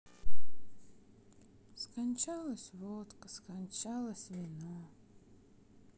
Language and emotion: Russian, sad